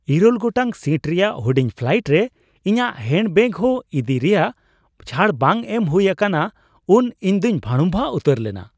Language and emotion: Santali, surprised